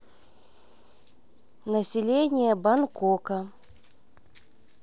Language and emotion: Russian, neutral